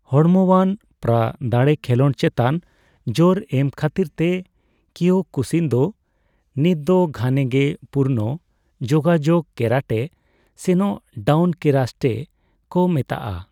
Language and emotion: Santali, neutral